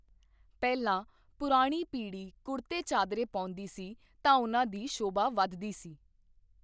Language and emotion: Punjabi, neutral